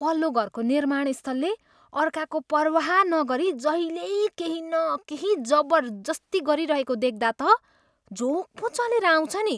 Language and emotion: Nepali, disgusted